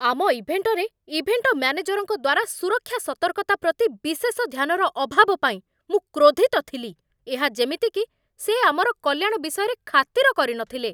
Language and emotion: Odia, angry